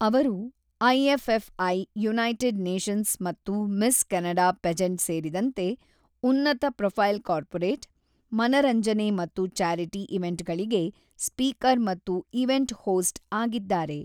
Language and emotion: Kannada, neutral